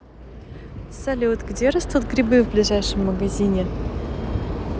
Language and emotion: Russian, positive